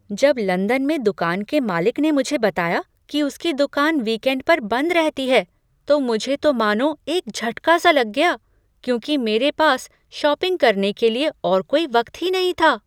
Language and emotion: Hindi, surprised